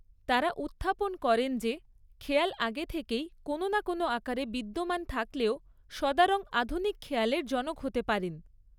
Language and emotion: Bengali, neutral